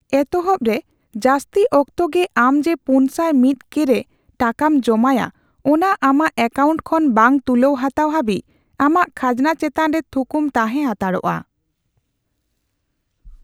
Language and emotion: Santali, neutral